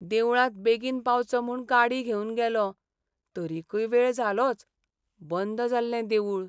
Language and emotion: Goan Konkani, sad